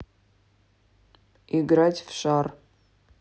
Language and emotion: Russian, neutral